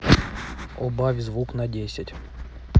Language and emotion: Russian, neutral